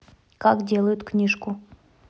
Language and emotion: Russian, neutral